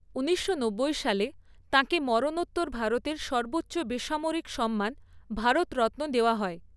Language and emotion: Bengali, neutral